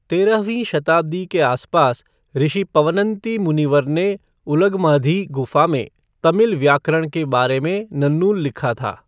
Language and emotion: Hindi, neutral